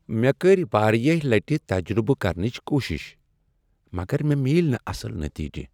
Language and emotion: Kashmiri, sad